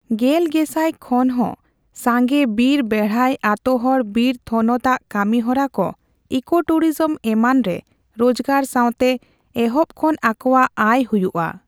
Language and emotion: Santali, neutral